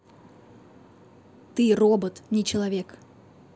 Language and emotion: Russian, neutral